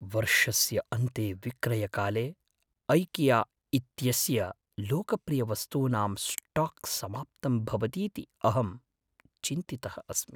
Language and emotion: Sanskrit, fearful